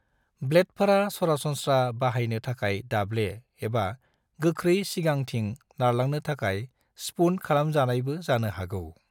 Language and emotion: Bodo, neutral